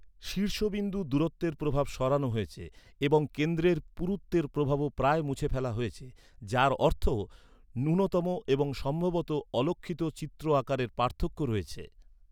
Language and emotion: Bengali, neutral